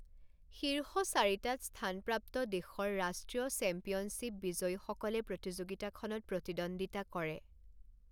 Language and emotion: Assamese, neutral